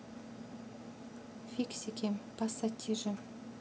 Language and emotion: Russian, neutral